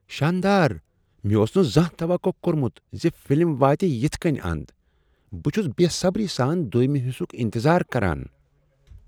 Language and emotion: Kashmiri, surprised